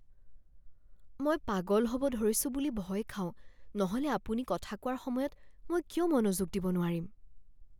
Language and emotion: Assamese, fearful